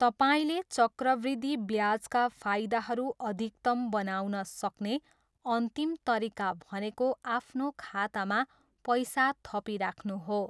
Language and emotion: Nepali, neutral